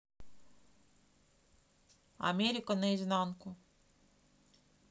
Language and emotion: Russian, neutral